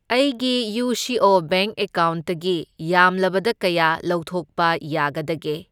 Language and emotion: Manipuri, neutral